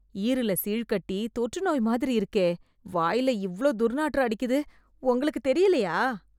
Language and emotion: Tamil, disgusted